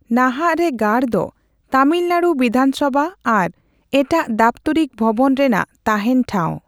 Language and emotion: Santali, neutral